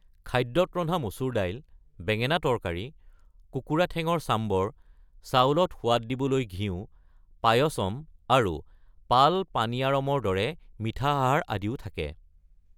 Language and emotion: Assamese, neutral